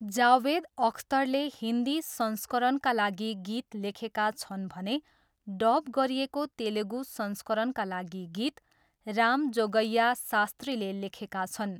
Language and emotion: Nepali, neutral